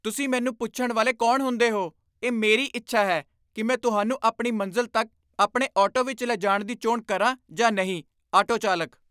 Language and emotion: Punjabi, angry